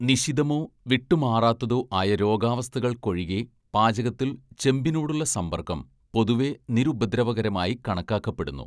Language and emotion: Malayalam, neutral